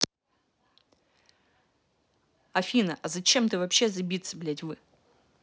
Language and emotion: Russian, angry